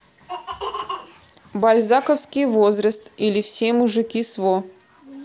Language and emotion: Russian, neutral